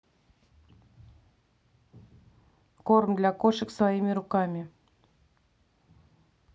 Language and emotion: Russian, neutral